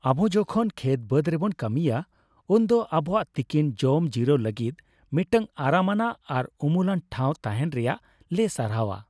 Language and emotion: Santali, happy